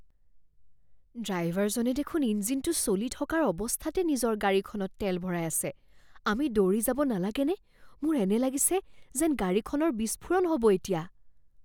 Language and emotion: Assamese, fearful